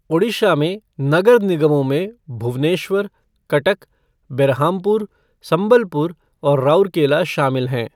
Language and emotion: Hindi, neutral